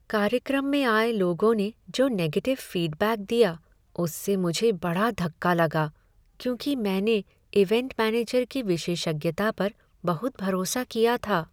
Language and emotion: Hindi, sad